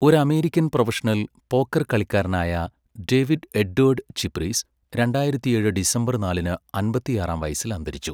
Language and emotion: Malayalam, neutral